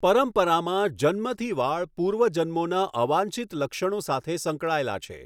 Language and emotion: Gujarati, neutral